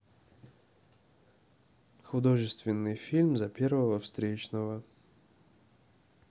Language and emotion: Russian, neutral